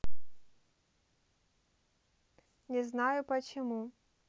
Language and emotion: Russian, neutral